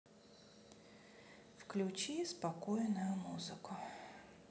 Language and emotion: Russian, neutral